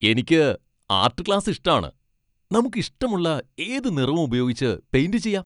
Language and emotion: Malayalam, happy